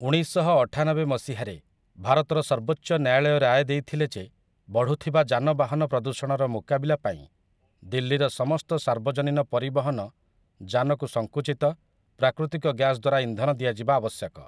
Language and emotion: Odia, neutral